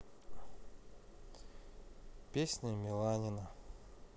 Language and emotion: Russian, neutral